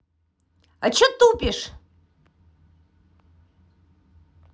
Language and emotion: Russian, angry